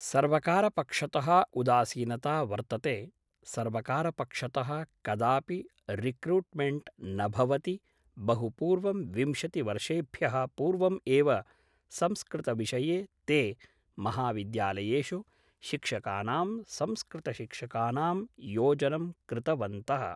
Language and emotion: Sanskrit, neutral